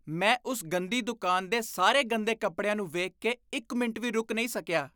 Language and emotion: Punjabi, disgusted